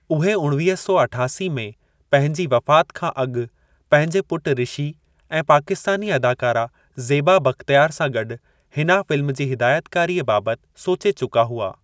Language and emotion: Sindhi, neutral